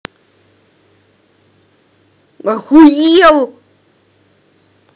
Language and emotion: Russian, angry